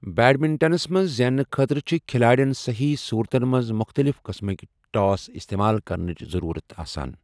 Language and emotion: Kashmiri, neutral